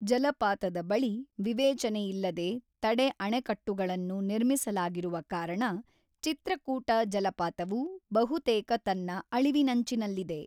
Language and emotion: Kannada, neutral